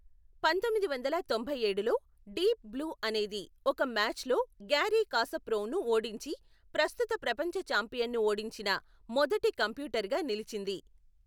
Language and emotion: Telugu, neutral